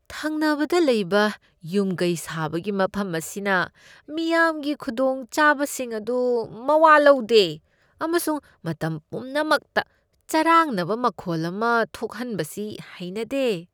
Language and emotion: Manipuri, disgusted